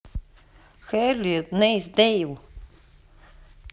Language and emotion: Russian, neutral